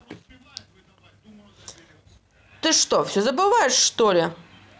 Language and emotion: Russian, angry